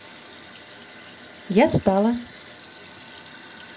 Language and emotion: Russian, positive